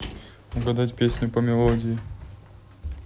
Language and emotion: Russian, neutral